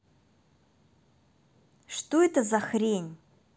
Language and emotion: Russian, angry